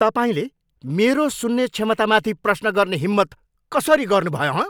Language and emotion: Nepali, angry